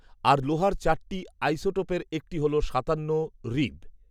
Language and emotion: Bengali, neutral